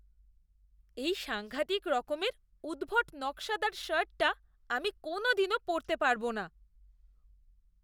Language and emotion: Bengali, disgusted